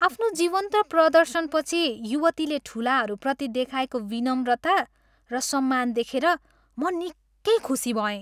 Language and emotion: Nepali, happy